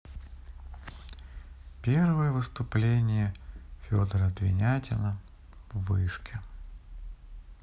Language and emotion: Russian, sad